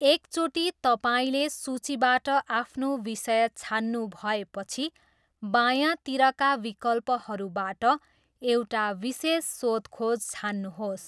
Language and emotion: Nepali, neutral